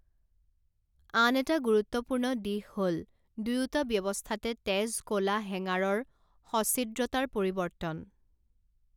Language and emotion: Assamese, neutral